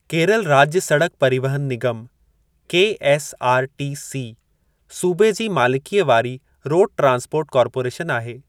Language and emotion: Sindhi, neutral